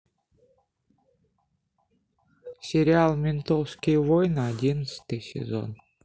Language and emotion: Russian, neutral